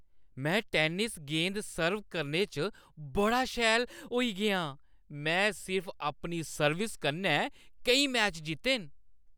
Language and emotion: Dogri, happy